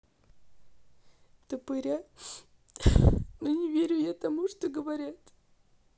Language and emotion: Russian, sad